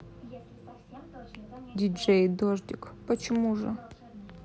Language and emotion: Russian, neutral